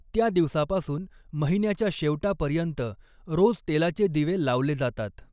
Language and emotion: Marathi, neutral